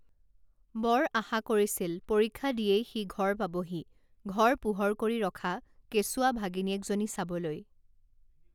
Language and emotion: Assamese, neutral